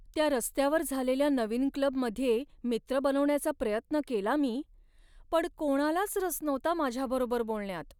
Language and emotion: Marathi, sad